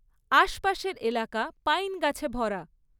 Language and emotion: Bengali, neutral